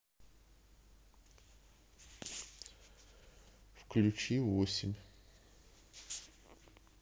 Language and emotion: Russian, neutral